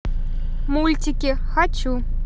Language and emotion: Russian, positive